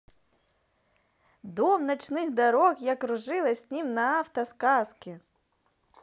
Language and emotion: Russian, positive